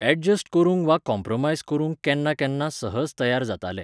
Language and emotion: Goan Konkani, neutral